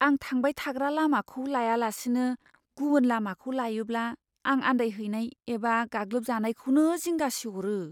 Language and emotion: Bodo, fearful